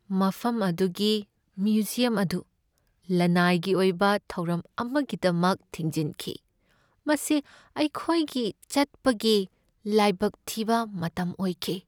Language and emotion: Manipuri, sad